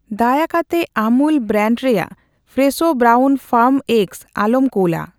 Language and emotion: Santali, neutral